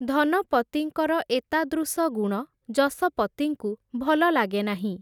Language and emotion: Odia, neutral